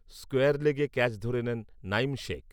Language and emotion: Bengali, neutral